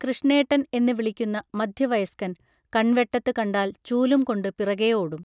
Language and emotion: Malayalam, neutral